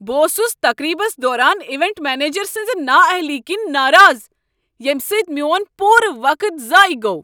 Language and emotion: Kashmiri, angry